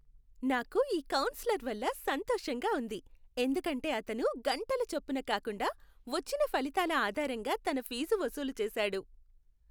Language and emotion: Telugu, happy